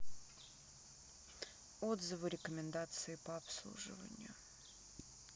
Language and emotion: Russian, neutral